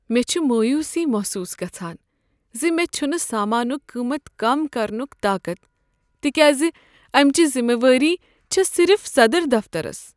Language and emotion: Kashmiri, sad